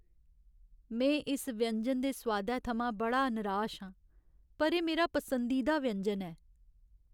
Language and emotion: Dogri, sad